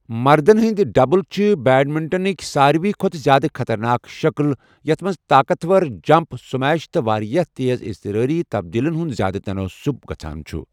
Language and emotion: Kashmiri, neutral